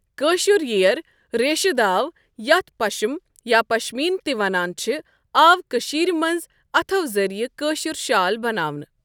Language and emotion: Kashmiri, neutral